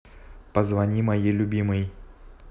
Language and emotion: Russian, neutral